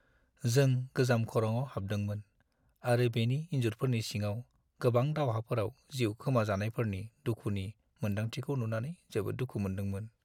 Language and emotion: Bodo, sad